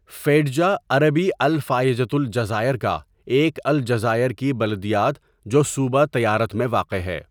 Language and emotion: Urdu, neutral